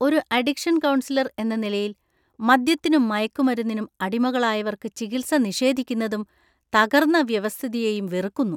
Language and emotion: Malayalam, disgusted